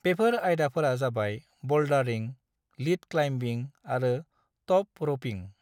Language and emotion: Bodo, neutral